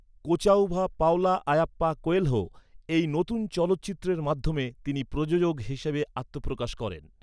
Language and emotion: Bengali, neutral